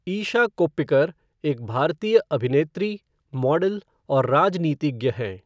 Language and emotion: Hindi, neutral